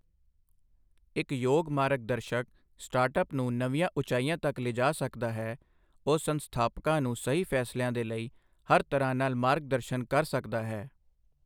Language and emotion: Punjabi, neutral